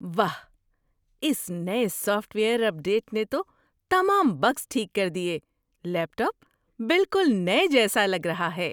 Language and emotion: Urdu, surprised